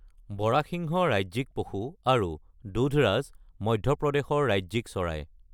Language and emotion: Assamese, neutral